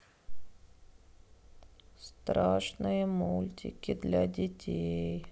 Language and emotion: Russian, sad